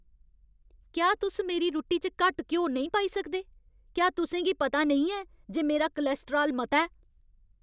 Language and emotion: Dogri, angry